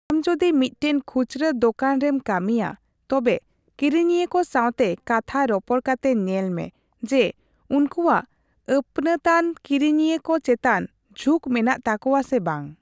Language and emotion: Santali, neutral